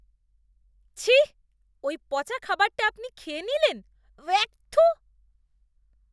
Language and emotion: Bengali, disgusted